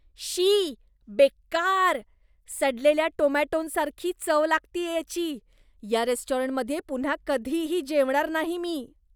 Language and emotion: Marathi, disgusted